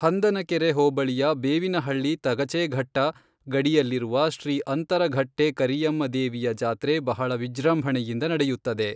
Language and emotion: Kannada, neutral